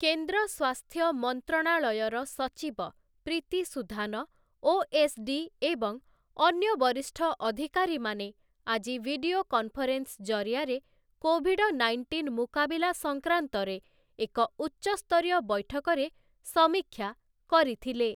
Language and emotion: Odia, neutral